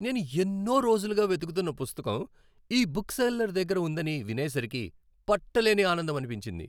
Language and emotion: Telugu, happy